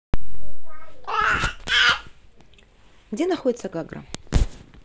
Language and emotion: Russian, neutral